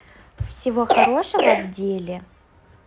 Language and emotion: Russian, positive